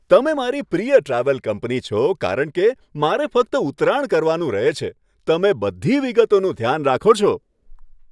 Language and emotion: Gujarati, happy